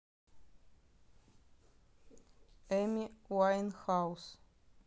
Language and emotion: Russian, neutral